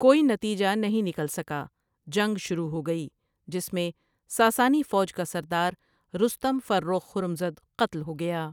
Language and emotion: Urdu, neutral